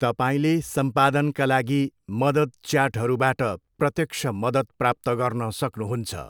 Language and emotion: Nepali, neutral